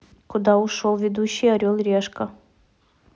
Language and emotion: Russian, neutral